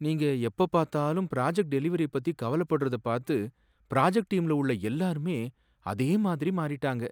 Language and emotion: Tamil, sad